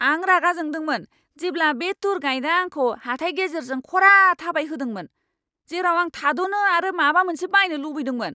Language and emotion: Bodo, angry